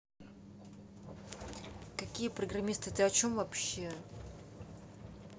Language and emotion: Russian, angry